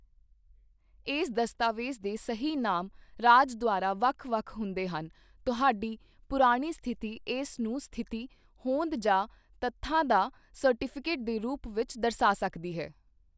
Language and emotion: Punjabi, neutral